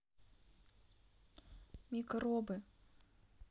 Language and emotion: Russian, neutral